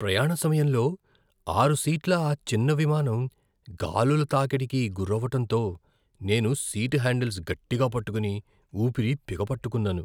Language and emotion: Telugu, fearful